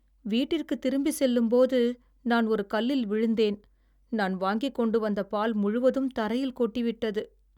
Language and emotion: Tamil, sad